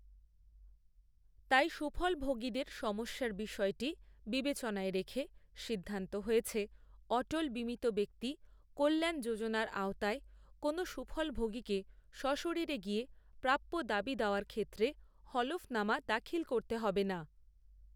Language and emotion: Bengali, neutral